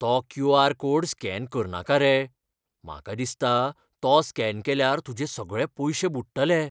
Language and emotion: Goan Konkani, fearful